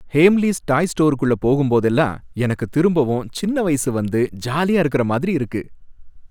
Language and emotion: Tamil, happy